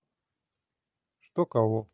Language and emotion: Russian, neutral